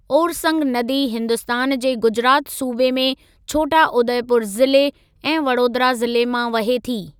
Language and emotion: Sindhi, neutral